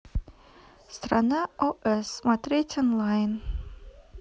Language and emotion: Russian, neutral